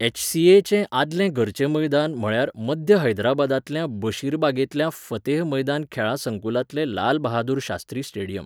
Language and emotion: Goan Konkani, neutral